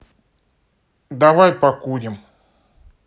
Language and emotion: Russian, neutral